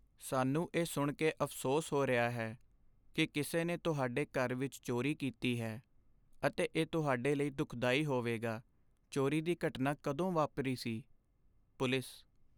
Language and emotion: Punjabi, sad